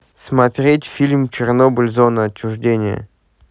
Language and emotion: Russian, neutral